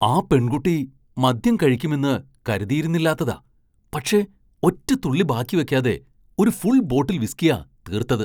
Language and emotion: Malayalam, surprised